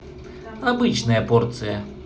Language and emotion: Russian, neutral